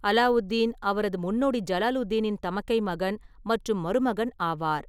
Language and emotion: Tamil, neutral